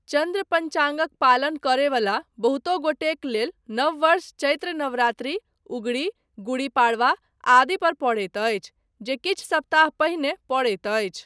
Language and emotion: Maithili, neutral